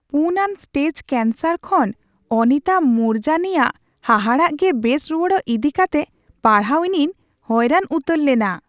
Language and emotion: Santali, surprised